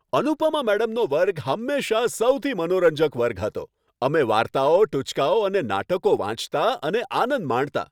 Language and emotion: Gujarati, happy